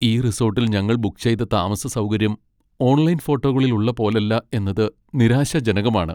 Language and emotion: Malayalam, sad